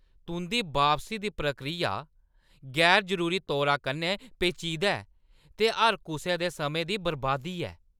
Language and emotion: Dogri, angry